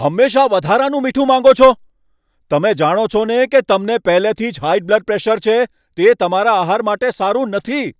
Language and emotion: Gujarati, angry